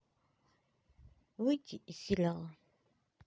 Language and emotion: Russian, neutral